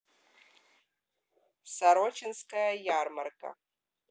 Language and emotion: Russian, neutral